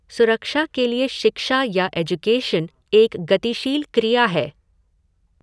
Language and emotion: Hindi, neutral